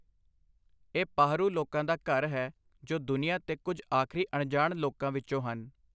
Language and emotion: Punjabi, neutral